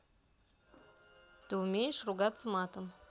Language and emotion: Russian, neutral